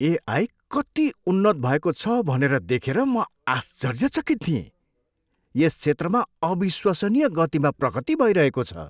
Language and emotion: Nepali, surprised